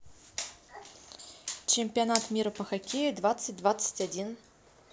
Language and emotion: Russian, neutral